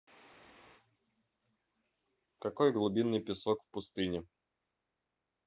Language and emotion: Russian, neutral